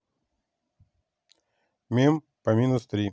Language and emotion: Russian, neutral